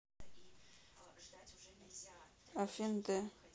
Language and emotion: Russian, neutral